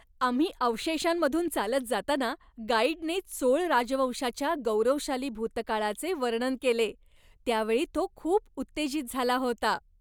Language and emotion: Marathi, happy